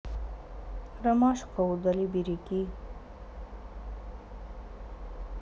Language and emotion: Russian, sad